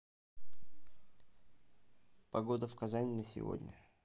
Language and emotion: Russian, neutral